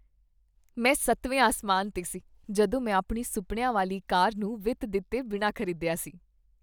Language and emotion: Punjabi, happy